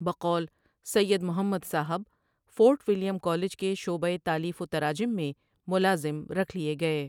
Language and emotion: Urdu, neutral